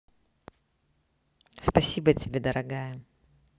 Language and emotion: Russian, neutral